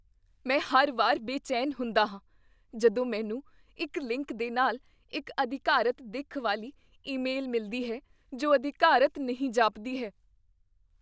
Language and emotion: Punjabi, fearful